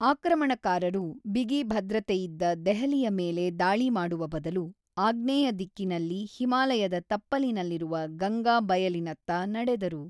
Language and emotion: Kannada, neutral